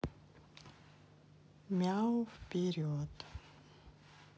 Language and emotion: Russian, neutral